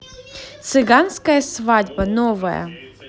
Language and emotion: Russian, positive